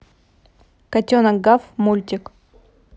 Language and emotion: Russian, neutral